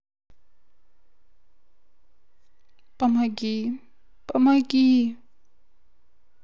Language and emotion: Russian, sad